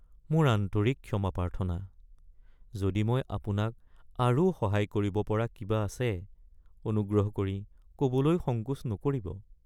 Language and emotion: Assamese, sad